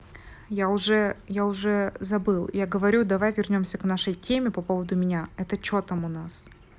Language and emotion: Russian, neutral